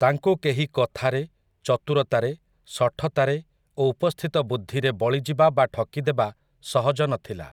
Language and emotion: Odia, neutral